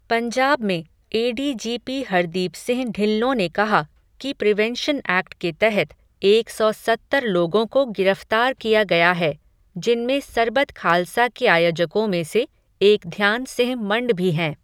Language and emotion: Hindi, neutral